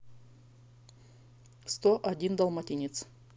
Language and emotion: Russian, neutral